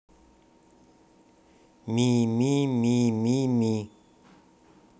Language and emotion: Russian, neutral